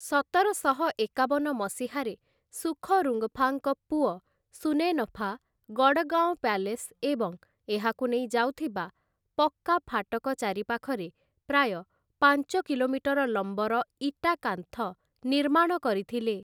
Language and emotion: Odia, neutral